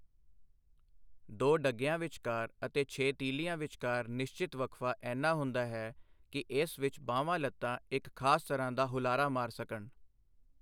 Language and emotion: Punjabi, neutral